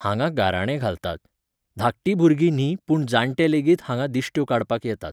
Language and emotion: Goan Konkani, neutral